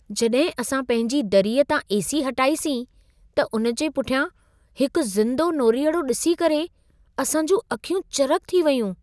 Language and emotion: Sindhi, surprised